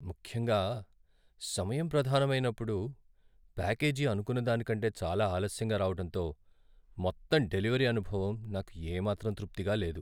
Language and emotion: Telugu, sad